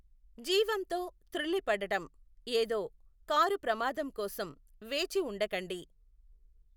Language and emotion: Telugu, neutral